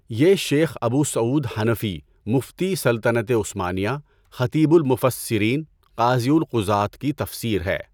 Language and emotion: Urdu, neutral